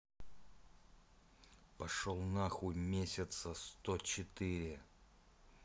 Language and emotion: Russian, angry